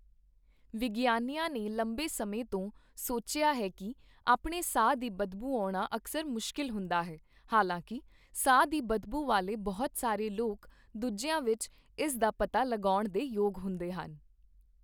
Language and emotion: Punjabi, neutral